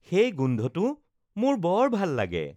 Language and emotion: Assamese, happy